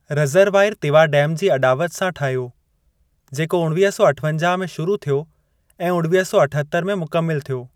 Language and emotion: Sindhi, neutral